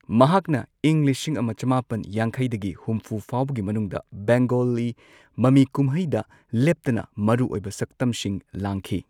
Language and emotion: Manipuri, neutral